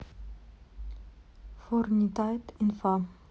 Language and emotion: Russian, neutral